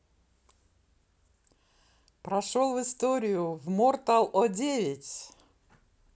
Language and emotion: Russian, positive